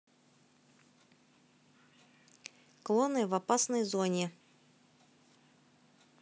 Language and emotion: Russian, neutral